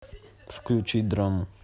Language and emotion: Russian, neutral